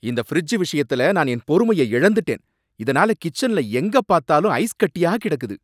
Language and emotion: Tamil, angry